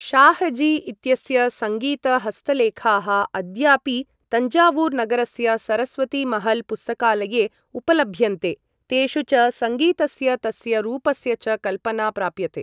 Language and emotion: Sanskrit, neutral